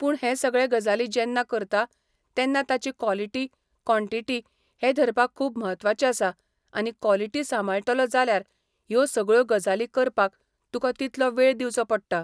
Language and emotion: Goan Konkani, neutral